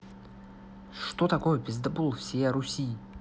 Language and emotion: Russian, neutral